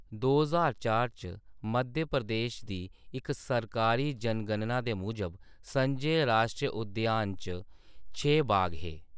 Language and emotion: Dogri, neutral